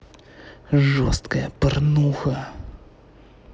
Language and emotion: Russian, angry